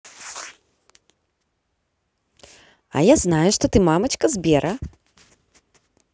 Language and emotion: Russian, positive